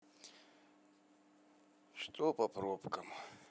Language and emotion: Russian, sad